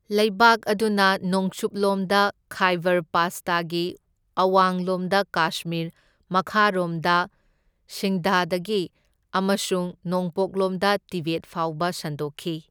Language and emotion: Manipuri, neutral